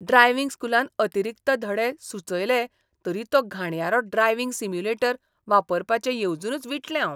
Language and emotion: Goan Konkani, disgusted